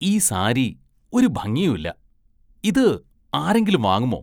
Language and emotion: Malayalam, disgusted